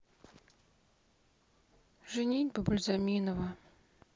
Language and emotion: Russian, sad